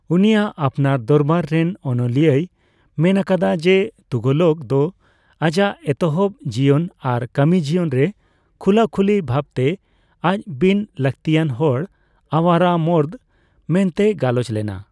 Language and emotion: Santali, neutral